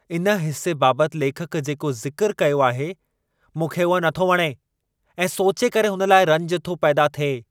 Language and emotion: Sindhi, angry